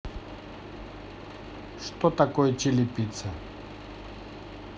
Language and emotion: Russian, neutral